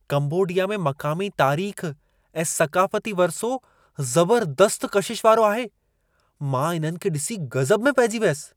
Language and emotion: Sindhi, surprised